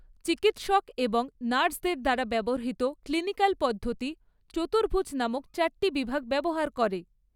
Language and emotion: Bengali, neutral